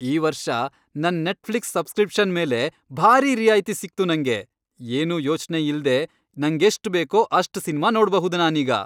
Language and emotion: Kannada, happy